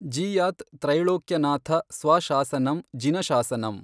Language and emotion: Kannada, neutral